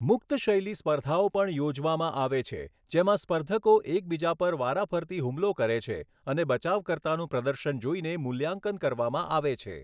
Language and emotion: Gujarati, neutral